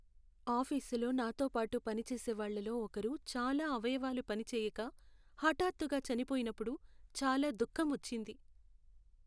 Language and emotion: Telugu, sad